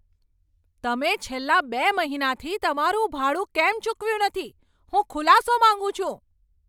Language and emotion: Gujarati, angry